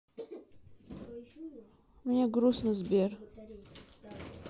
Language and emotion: Russian, sad